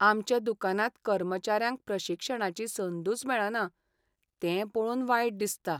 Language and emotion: Goan Konkani, sad